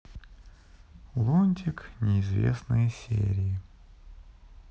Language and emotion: Russian, sad